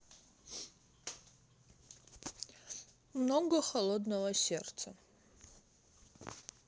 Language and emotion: Russian, neutral